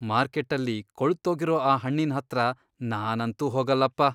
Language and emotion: Kannada, disgusted